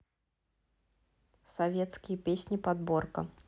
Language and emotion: Russian, neutral